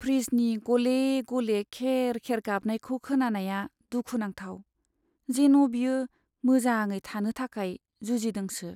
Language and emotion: Bodo, sad